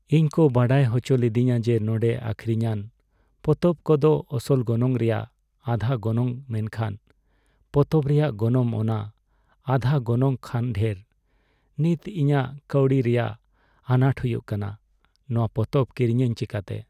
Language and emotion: Santali, sad